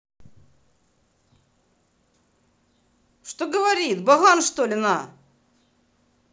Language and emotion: Russian, angry